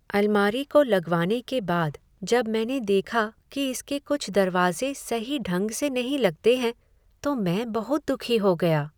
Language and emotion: Hindi, sad